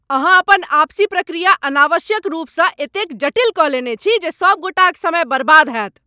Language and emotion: Maithili, angry